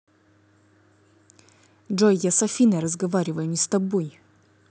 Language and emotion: Russian, angry